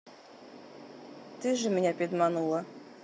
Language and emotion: Russian, neutral